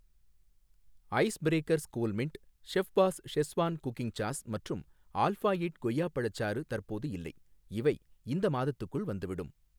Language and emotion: Tamil, neutral